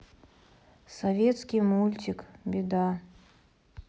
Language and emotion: Russian, sad